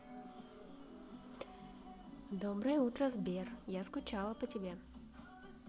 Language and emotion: Russian, positive